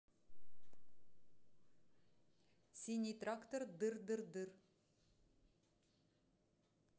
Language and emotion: Russian, neutral